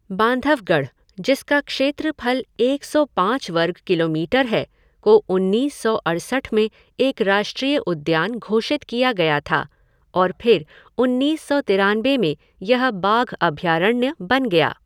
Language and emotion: Hindi, neutral